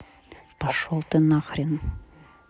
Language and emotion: Russian, angry